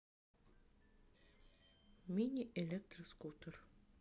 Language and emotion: Russian, neutral